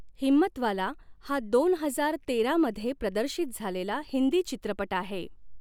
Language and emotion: Marathi, neutral